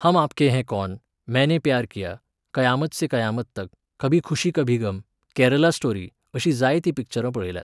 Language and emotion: Goan Konkani, neutral